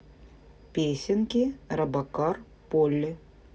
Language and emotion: Russian, neutral